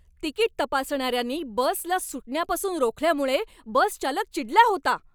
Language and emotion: Marathi, angry